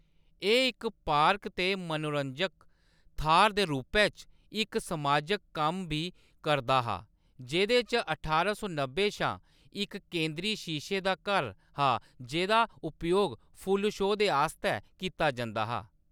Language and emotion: Dogri, neutral